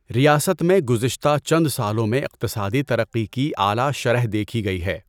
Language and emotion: Urdu, neutral